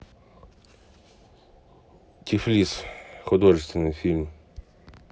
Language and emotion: Russian, neutral